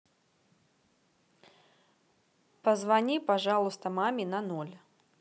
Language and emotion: Russian, neutral